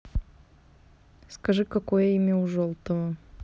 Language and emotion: Russian, neutral